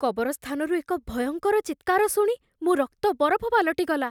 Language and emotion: Odia, fearful